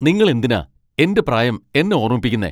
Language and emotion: Malayalam, angry